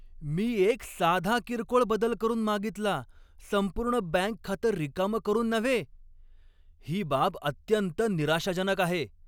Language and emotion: Marathi, angry